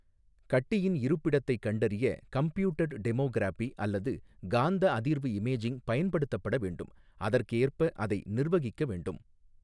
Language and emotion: Tamil, neutral